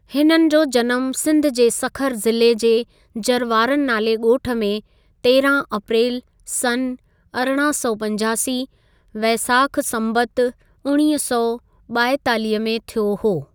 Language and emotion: Sindhi, neutral